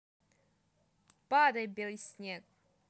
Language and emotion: Russian, positive